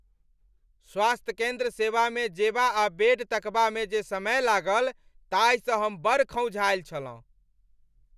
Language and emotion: Maithili, angry